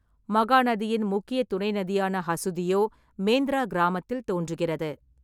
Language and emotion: Tamil, neutral